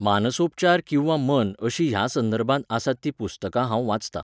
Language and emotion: Goan Konkani, neutral